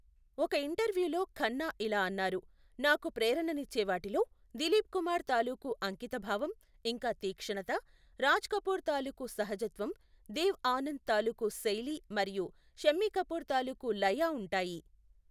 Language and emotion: Telugu, neutral